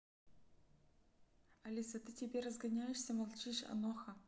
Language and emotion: Russian, neutral